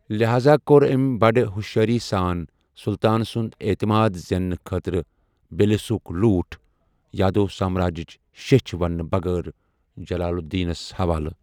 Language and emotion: Kashmiri, neutral